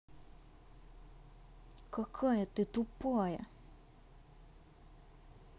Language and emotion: Russian, angry